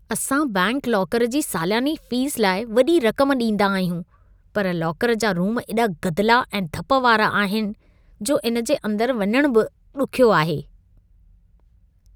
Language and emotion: Sindhi, disgusted